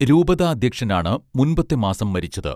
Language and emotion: Malayalam, neutral